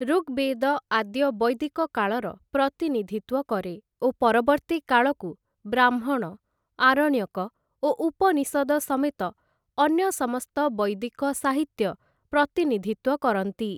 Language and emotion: Odia, neutral